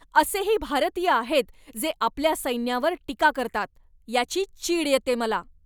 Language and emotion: Marathi, angry